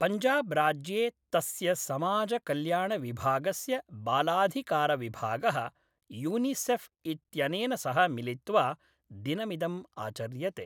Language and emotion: Sanskrit, neutral